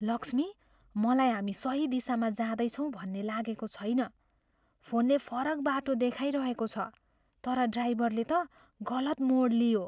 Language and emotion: Nepali, fearful